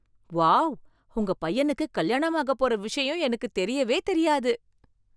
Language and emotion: Tamil, surprised